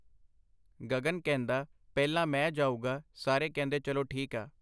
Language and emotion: Punjabi, neutral